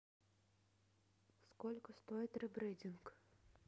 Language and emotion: Russian, neutral